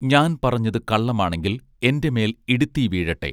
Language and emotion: Malayalam, neutral